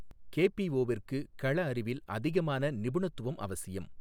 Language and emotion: Tamil, neutral